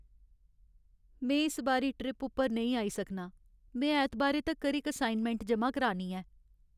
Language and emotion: Dogri, sad